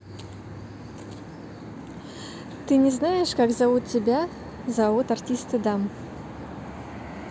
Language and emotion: Russian, neutral